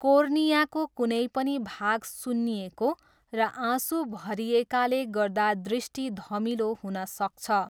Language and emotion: Nepali, neutral